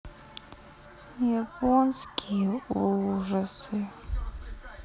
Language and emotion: Russian, sad